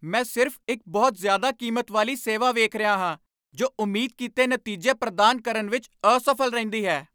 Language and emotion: Punjabi, angry